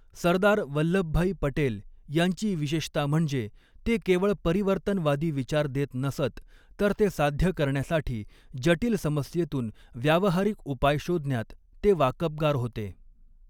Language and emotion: Marathi, neutral